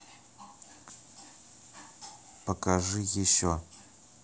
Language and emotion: Russian, neutral